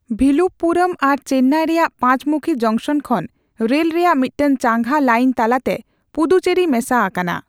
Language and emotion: Santali, neutral